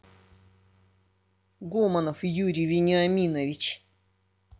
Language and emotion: Russian, angry